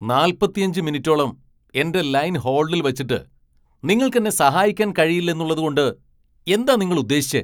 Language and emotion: Malayalam, angry